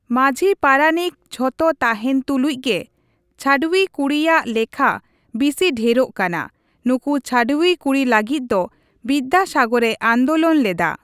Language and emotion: Santali, neutral